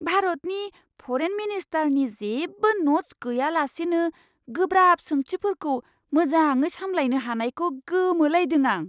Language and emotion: Bodo, surprised